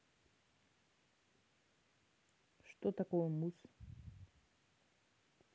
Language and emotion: Russian, neutral